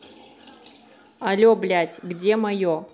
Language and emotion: Russian, angry